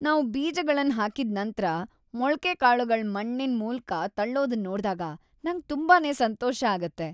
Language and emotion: Kannada, happy